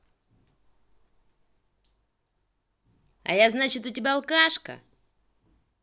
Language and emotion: Russian, angry